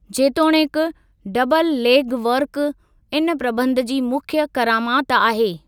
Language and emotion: Sindhi, neutral